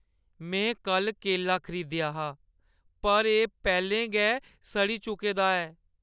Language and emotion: Dogri, sad